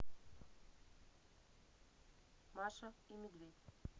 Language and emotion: Russian, neutral